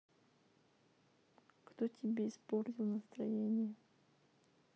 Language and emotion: Russian, sad